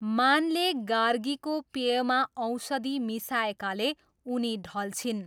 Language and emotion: Nepali, neutral